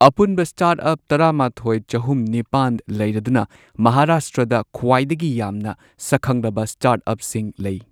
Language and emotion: Manipuri, neutral